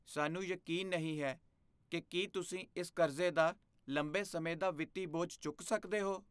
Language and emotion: Punjabi, fearful